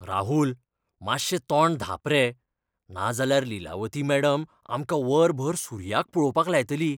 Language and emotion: Goan Konkani, fearful